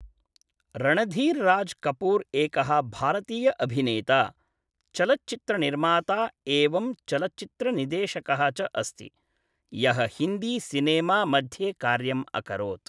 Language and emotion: Sanskrit, neutral